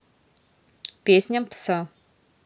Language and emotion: Russian, neutral